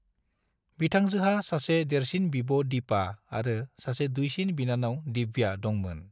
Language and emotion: Bodo, neutral